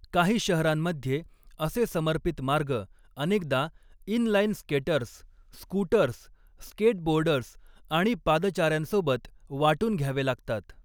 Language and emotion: Marathi, neutral